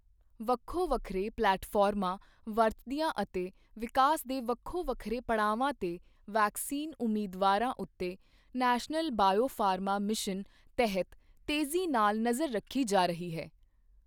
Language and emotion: Punjabi, neutral